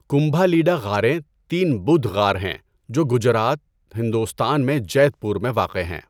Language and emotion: Urdu, neutral